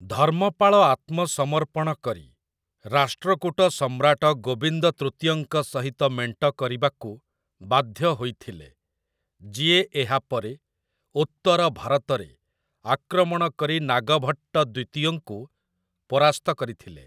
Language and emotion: Odia, neutral